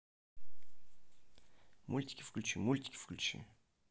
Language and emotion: Russian, neutral